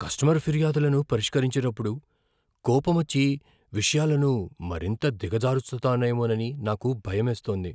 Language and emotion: Telugu, fearful